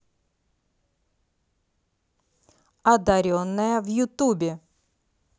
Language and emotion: Russian, positive